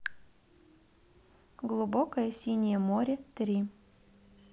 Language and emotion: Russian, neutral